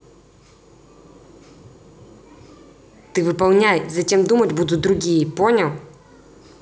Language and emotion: Russian, angry